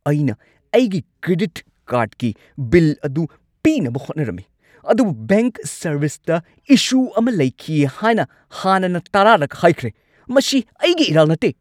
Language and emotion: Manipuri, angry